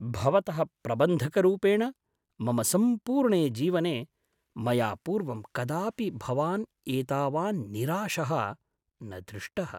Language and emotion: Sanskrit, surprised